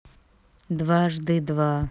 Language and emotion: Russian, neutral